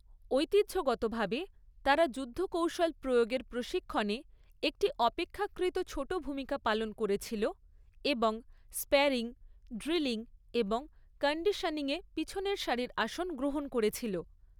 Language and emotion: Bengali, neutral